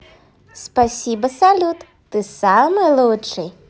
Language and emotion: Russian, positive